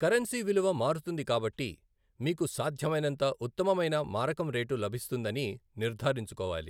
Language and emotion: Telugu, neutral